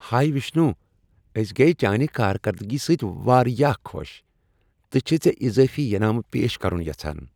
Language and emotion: Kashmiri, happy